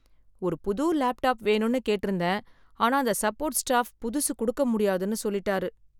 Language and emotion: Tamil, sad